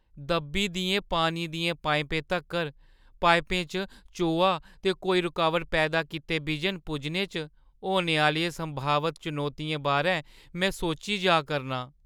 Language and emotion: Dogri, fearful